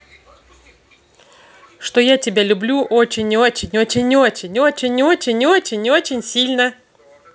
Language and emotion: Russian, positive